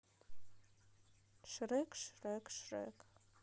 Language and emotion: Russian, neutral